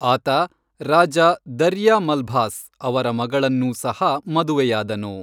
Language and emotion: Kannada, neutral